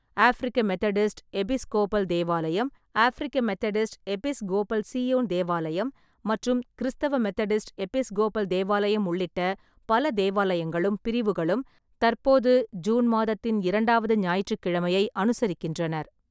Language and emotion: Tamil, neutral